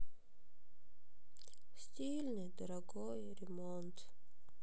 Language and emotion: Russian, sad